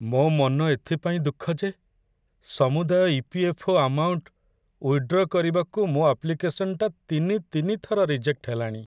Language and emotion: Odia, sad